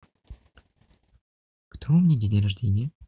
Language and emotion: Russian, positive